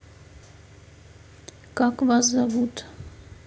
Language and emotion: Russian, neutral